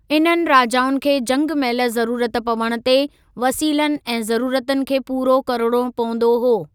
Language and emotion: Sindhi, neutral